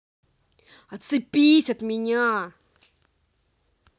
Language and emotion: Russian, angry